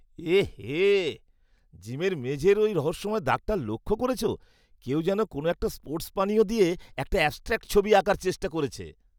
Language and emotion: Bengali, disgusted